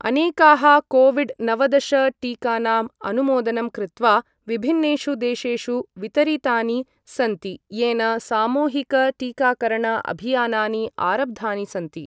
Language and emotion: Sanskrit, neutral